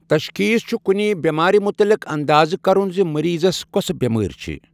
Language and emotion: Kashmiri, neutral